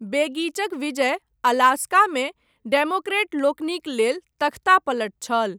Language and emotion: Maithili, neutral